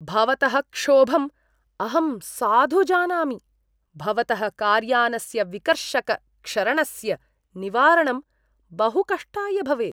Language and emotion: Sanskrit, disgusted